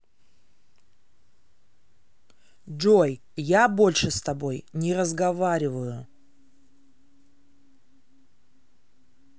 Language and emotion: Russian, angry